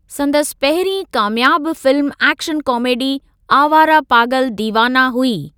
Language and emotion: Sindhi, neutral